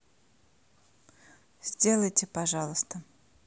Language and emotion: Russian, neutral